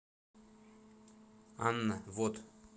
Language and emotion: Russian, neutral